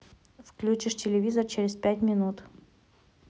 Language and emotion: Russian, neutral